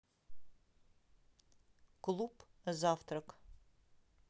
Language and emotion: Russian, neutral